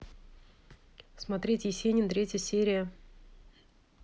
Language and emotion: Russian, neutral